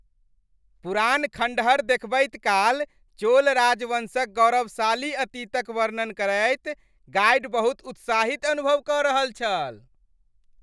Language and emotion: Maithili, happy